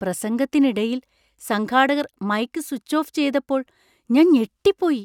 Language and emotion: Malayalam, surprised